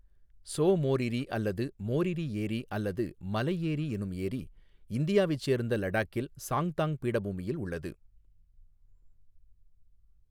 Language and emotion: Tamil, neutral